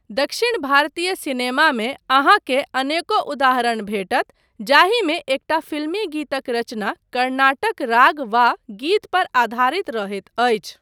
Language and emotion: Maithili, neutral